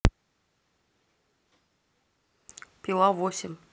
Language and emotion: Russian, neutral